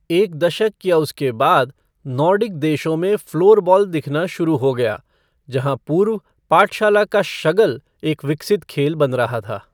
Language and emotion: Hindi, neutral